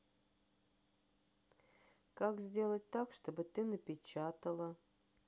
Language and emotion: Russian, sad